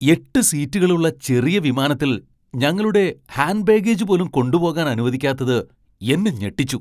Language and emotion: Malayalam, surprised